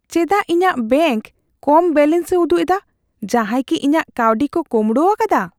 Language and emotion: Santali, fearful